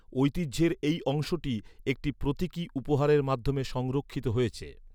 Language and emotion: Bengali, neutral